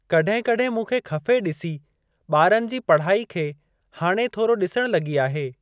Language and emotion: Sindhi, neutral